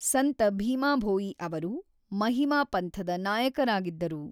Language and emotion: Kannada, neutral